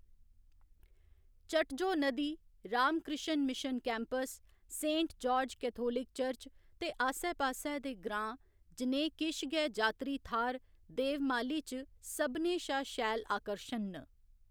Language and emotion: Dogri, neutral